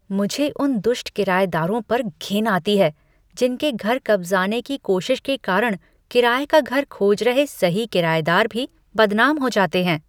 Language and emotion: Hindi, disgusted